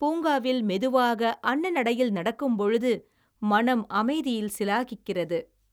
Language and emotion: Tamil, happy